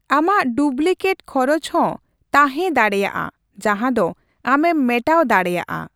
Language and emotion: Santali, neutral